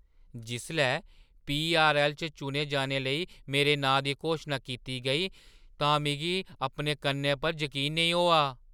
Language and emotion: Dogri, surprised